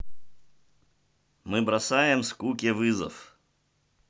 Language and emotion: Russian, neutral